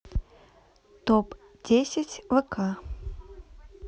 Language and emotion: Russian, neutral